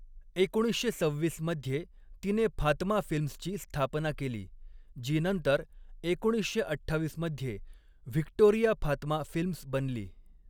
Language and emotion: Marathi, neutral